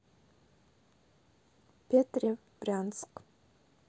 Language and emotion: Russian, neutral